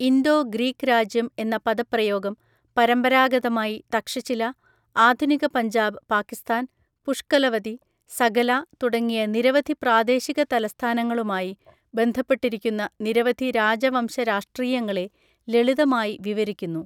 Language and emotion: Malayalam, neutral